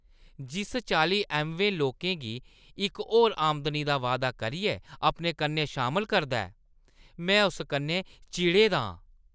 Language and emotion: Dogri, disgusted